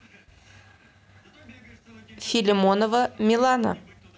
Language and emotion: Russian, neutral